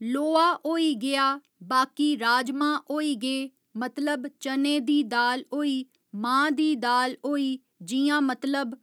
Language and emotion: Dogri, neutral